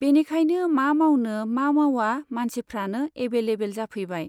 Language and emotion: Bodo, neutral